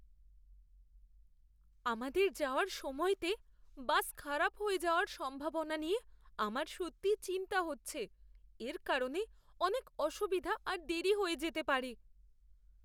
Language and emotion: Bengali, fearful